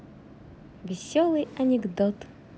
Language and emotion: Russian, positive